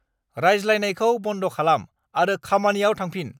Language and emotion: Bodo, angry